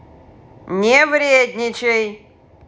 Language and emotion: Russian, angry